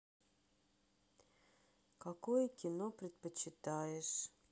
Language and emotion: Russian, sad